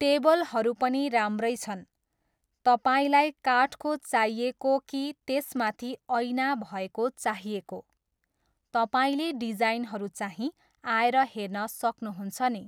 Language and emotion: Nepali, neutral